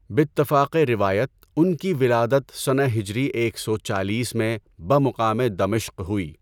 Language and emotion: Urdu, neutral